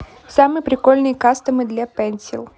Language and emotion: Russian, neutral